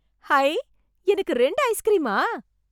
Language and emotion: Tamil, surprised